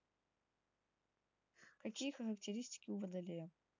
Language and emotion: Russian, neutral